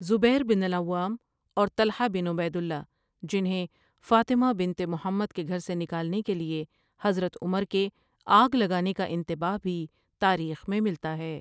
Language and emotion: Urdu, neutral